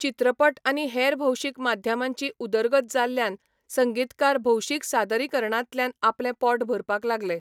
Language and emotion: Goan Konkani, neutral